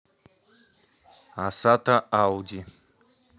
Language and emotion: Russian, neutral